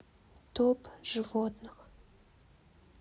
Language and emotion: Russian, sad